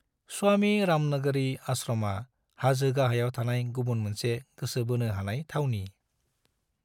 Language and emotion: Bodo, neutral